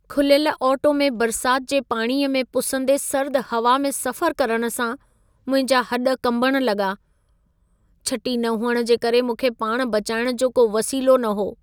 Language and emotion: Sindhi, sad